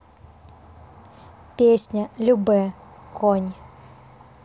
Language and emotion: Russian, neutral